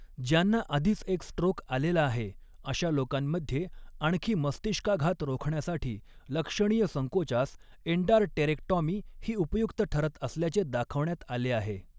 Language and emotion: Marathi, neutral